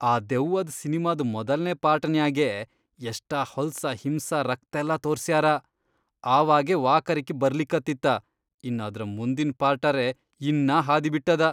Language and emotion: Kannada, disgusted